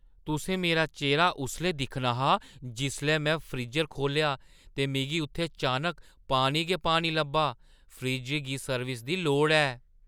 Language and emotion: Dogri, surprised